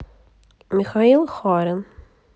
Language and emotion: Russian, neutral